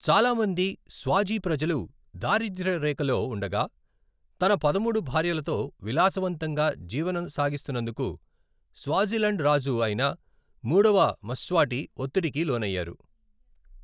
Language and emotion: Telugu, neutral